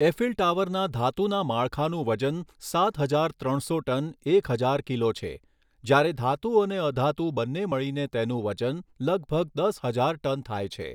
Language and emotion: Gujarati, neutral